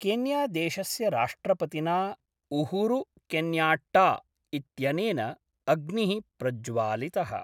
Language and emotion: Sanskrit, neutral